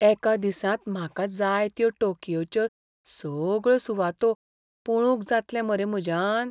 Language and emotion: Goan Konkani, fearful